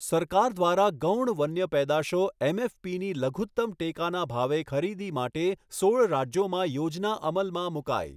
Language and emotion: Gujarati, neutral